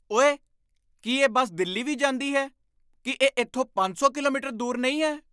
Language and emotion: Punjabi, surprised